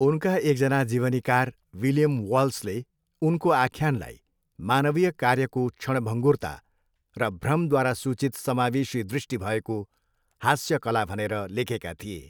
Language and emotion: Nepali, neutral